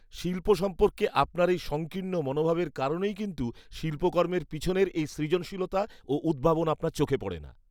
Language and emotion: Bengali, disgusted